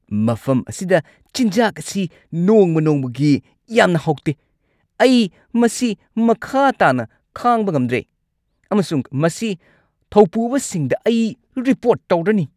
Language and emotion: Manipuri, angry